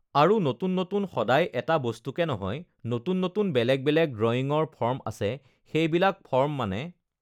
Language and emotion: Assamese, neutral